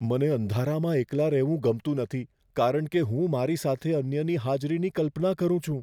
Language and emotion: Gujarati, fearful